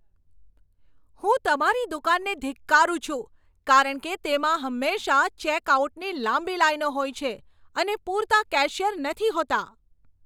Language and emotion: Gujarati, angry